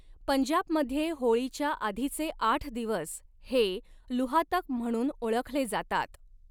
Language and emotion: Marathi, neutral